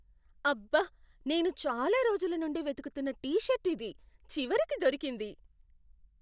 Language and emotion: Telugu, surprised